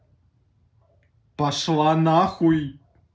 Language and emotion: Russian, angry